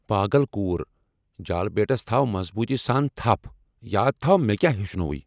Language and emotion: Kashmiri, angry